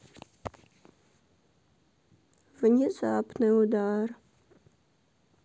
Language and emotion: Russian, sad